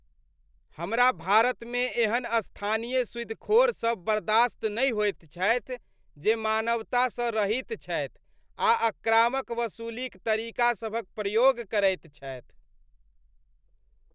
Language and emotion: Maithili, disgusted